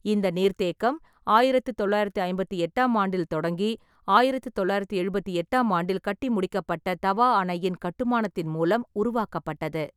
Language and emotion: Tamil, neutral